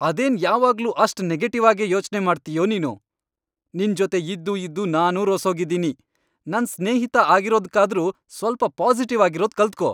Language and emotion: Kannada, angry